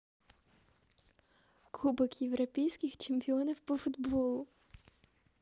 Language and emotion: Russian, positive